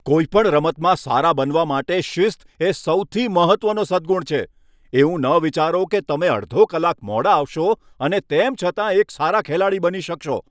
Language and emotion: Gujarati, angry